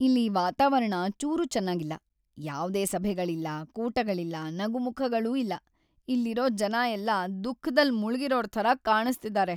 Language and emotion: Kannada, sad